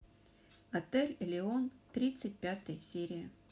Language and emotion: Russian, neutral